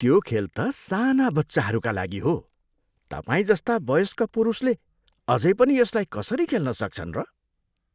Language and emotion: Nepali, disgusted